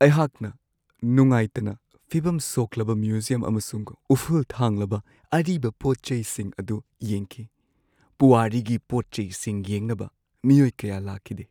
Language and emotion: Manipuri, sad